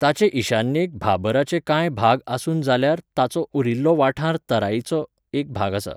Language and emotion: Goan Konkani, neutral